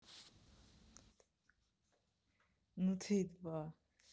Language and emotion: Russian, neutral